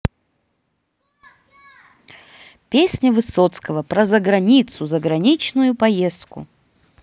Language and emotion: Russian, positive